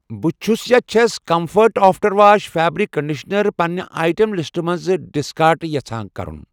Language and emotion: Kashmiri, neutral